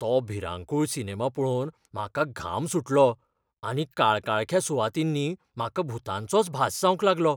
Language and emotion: Goan Konkani, fearful